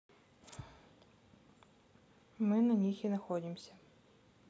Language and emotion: Russian, neutral